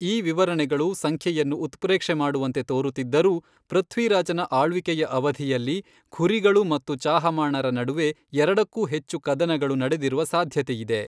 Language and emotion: Kannada, neutral